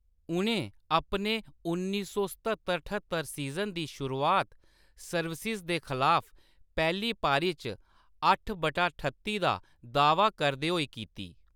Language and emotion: Dogri, neutral